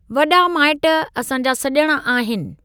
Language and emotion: Sindhi, neutral